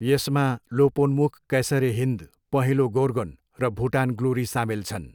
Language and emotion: Nepali, neutral